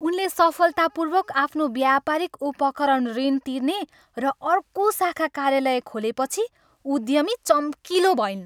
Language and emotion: Nepali, happy